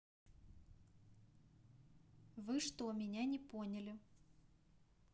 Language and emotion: Russian, neutral